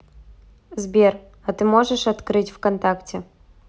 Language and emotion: Russian, neutral